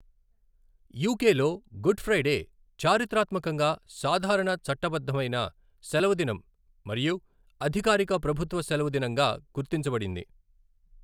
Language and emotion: Telugu, neutral